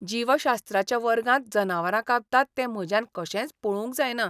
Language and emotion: Goan Konkani, disgusted